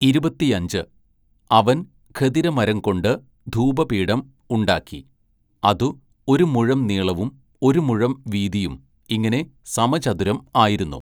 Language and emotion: Malayalam, neutral